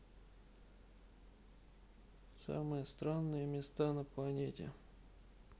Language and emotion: Russian, neutral